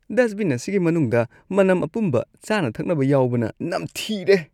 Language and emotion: Manipuri, disgusted